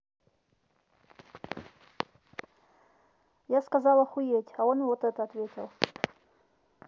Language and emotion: Russian, neutral